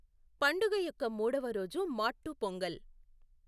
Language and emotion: Telugu, neutral